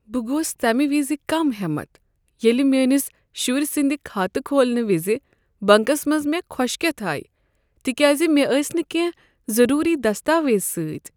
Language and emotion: Kashmiri, sad